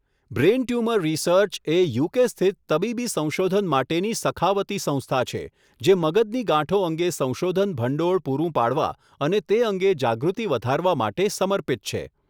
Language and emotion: Gujarati, neutral